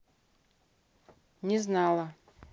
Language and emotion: Russian, neutral